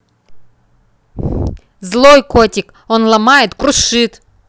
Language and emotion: Russian, neutral